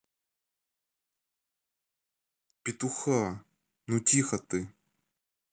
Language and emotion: Russian, neutral